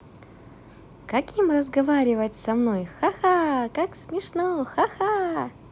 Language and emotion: Russian, positive